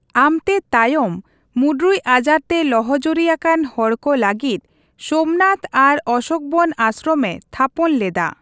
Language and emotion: Santali, neutral